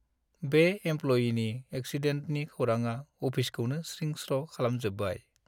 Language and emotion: Bodo, sad